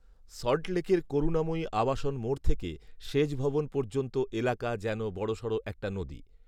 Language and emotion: Bengali, neutral